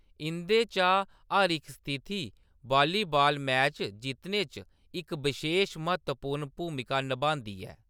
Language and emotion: Dogri, neutral